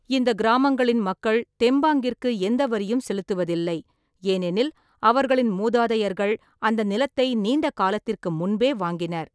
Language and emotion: Tamil, neutral